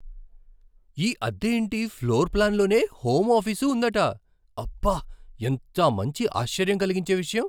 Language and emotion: Telugu, surprised